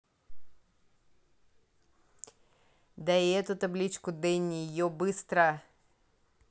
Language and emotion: Russian, angry